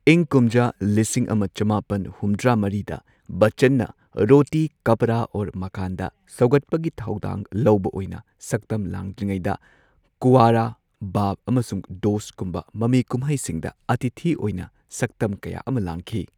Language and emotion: Manipuri, neutral